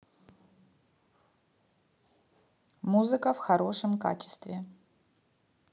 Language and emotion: Russian, neutral